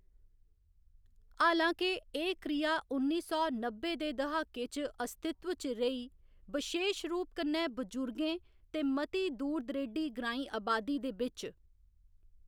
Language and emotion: Dogri, neutral